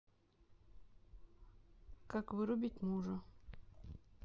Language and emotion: Russian, neutral